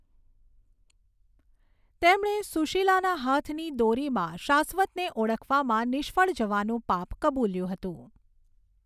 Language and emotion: Gujarati, neutral